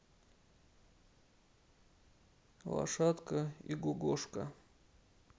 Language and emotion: Russian, neutral